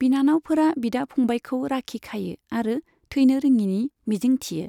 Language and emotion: Bodo, neutral